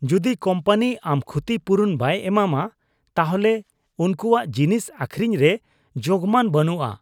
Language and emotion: Santali, disgusted